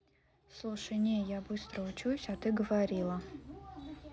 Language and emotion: Russian, neutral